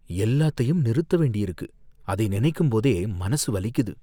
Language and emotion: Tamil, fearful